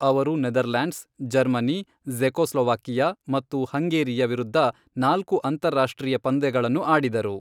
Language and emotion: Kannada, neutral